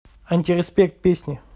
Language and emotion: Russian, neutral